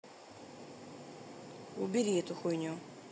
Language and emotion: Russian, neutral